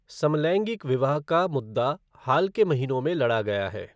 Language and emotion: Hindi, neutral